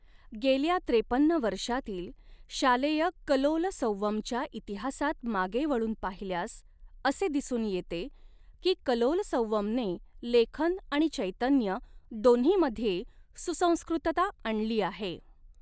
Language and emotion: Marathi, neutral